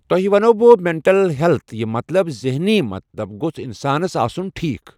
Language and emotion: Kashmiri, neutral